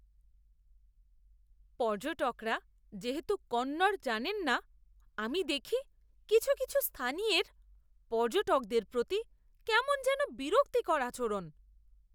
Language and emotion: Bengali, disgusted